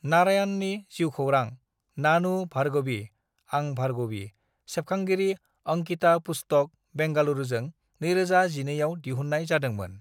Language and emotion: Bodo, neutral